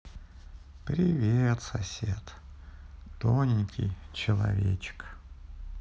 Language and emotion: Russian, sad